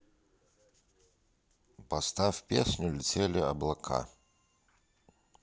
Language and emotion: Russian, neutral